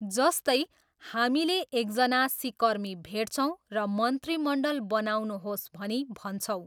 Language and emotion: Nepali, neutral